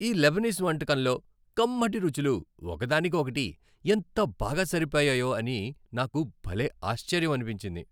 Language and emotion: Telugu, happy